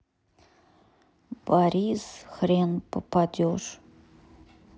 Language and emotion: Russian, sad